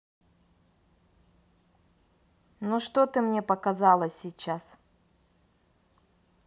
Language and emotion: Russian, neutral